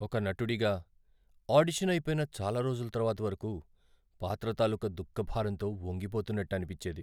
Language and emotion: Telugu, sad